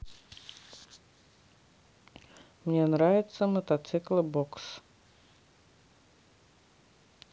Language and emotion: Russian, neutral